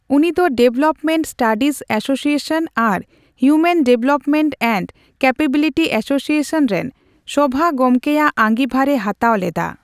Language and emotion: Santali, neutral